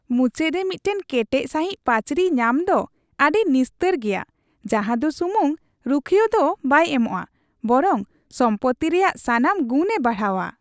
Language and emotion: Santali, happy